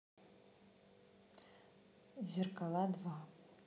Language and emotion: Russian, neutral